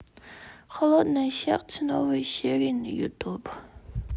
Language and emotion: Russian, sad